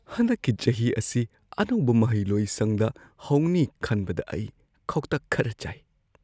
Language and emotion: Manipuri, fearful